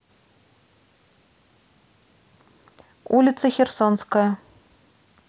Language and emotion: Russian, neutral